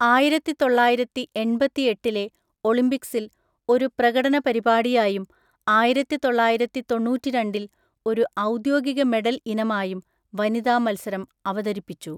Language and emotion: Malayalam, neutral